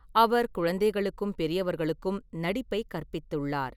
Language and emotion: Tamil, neutral